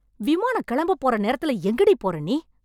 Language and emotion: Tamil, angry